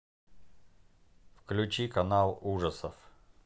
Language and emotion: Russian, neutral